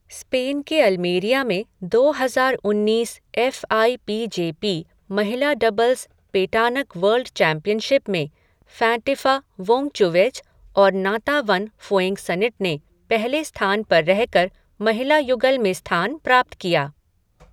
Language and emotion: Hindi, neutral